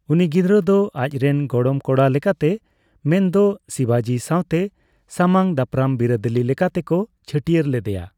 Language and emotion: Santali, neutral